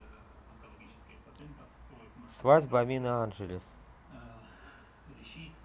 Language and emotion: Russian, neutral